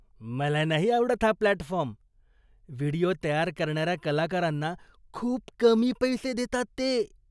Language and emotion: Marathi, disgusted